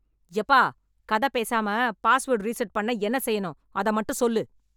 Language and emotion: Tamil, angry